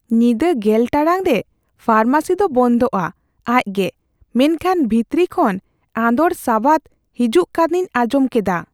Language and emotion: Santali, fearful